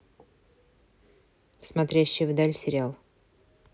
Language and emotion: Russian, neutral